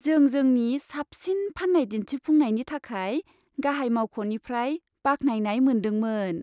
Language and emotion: Bodo, happy